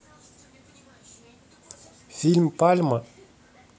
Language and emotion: Russian, neutral